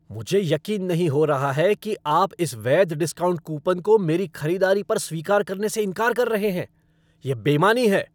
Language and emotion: Hindi, angry